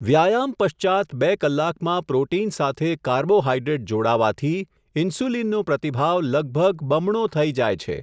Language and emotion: Gujarati, neutral